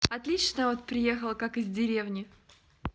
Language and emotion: Russian, positive